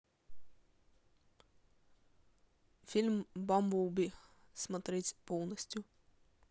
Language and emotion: Russian, neutral